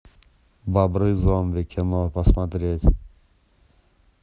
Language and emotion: Russian, neutral